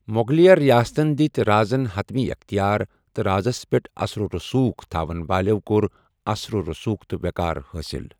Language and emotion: Kashmiri, neutral